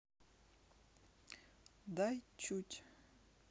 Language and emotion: Russian, neutral